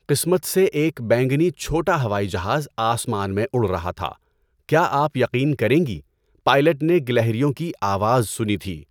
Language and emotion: Urdu, neutral